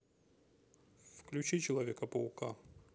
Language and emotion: Russian, neutral